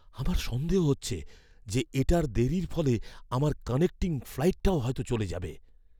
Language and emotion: Bengali, fearful